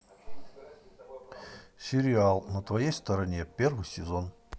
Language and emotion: Russian, neutral